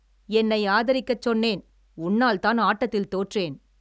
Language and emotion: Tamil, angry